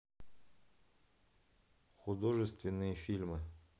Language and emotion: Russian, neutral